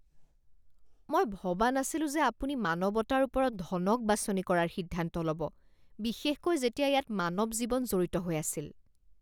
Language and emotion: Assamese, disgusted